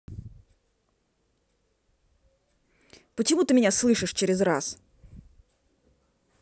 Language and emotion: Russian, angry